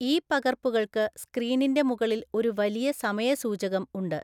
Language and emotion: Malayalam, neutral